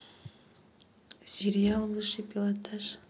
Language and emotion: Russian, neutral